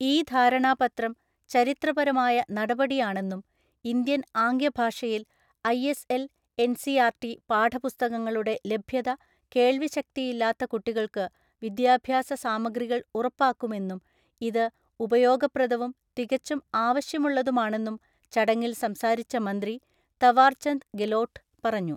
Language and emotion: Malayalam, neutral